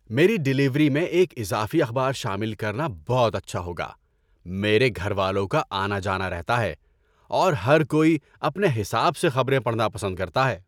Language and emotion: Urdu, happy